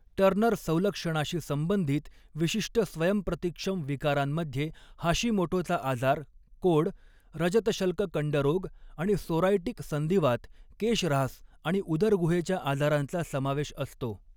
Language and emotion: Marathi, neutral